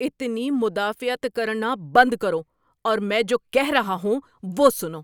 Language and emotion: Urdu, angry